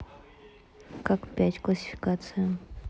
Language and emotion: Russian, neutral